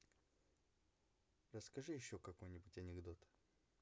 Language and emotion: Russian, neutral